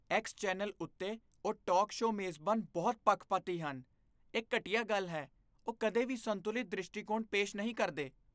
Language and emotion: Punjabi, disgusted